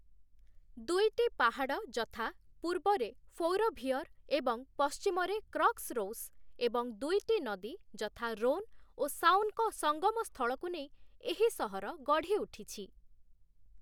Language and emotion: Odia, neutral